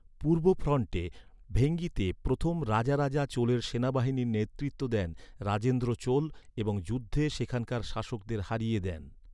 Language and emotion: Bengali, neutral